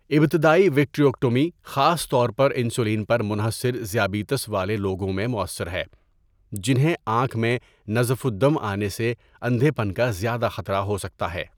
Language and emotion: Urdu, neutral